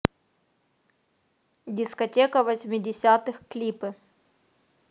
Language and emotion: Russian, neutral